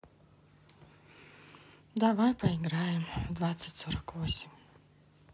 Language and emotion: Russian, sad